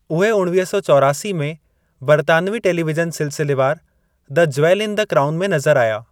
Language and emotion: Sindhi, neutral